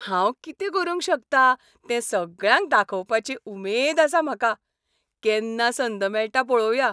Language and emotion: Goan Konkani, happy